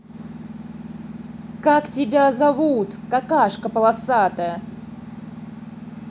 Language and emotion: Russian, angry